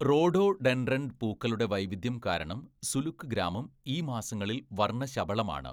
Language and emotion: Malayalam, neutral